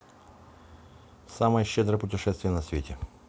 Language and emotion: Russian, neutral